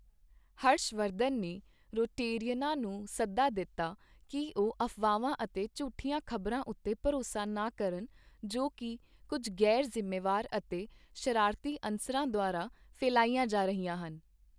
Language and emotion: Punjabi, neutral